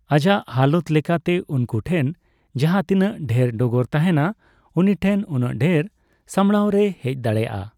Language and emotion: Santali, neutral